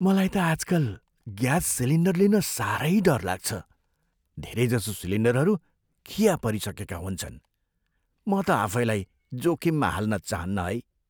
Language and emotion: Nepali, fearful